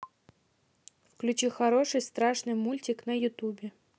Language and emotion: Russian, neutral